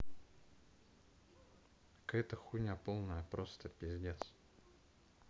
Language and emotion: Russian, neutral